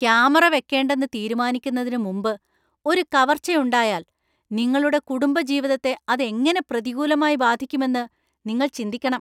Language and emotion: Malayalam, angry